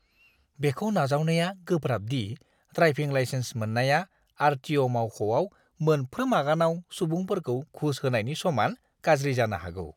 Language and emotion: Bodo, disgusted